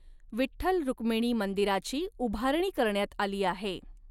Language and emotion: Marathi, neutral